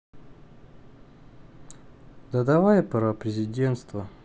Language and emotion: Russian, sad